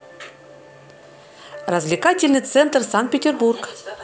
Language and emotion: Russian, positive